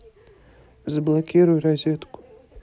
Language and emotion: Russian, neutral